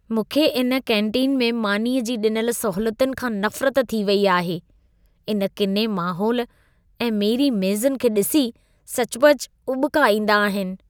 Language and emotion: Sindhi, disgusted